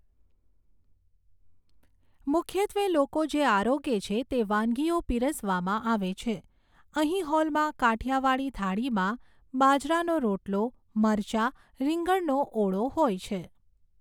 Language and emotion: Gujarati, neutral